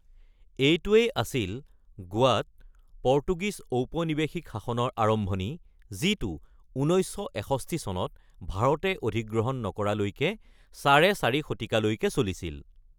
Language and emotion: Assamese, neutral